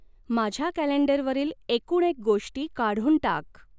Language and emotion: Marathi, neutral